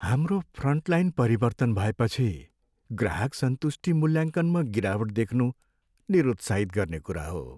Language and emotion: Nepali, sad